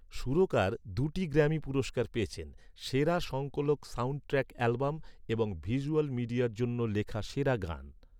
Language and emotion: Bengali, neutral